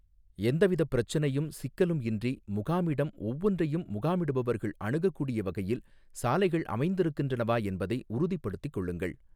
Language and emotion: Tamil, neutral